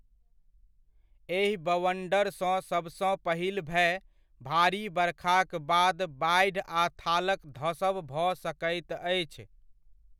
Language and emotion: Maithili, neutral